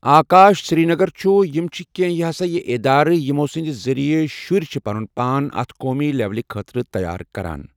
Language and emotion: Kashmiri, neutral